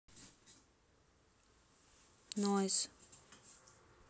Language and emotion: Russian, sad